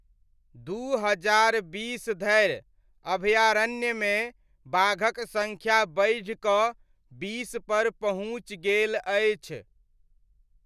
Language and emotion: Maithili, neutral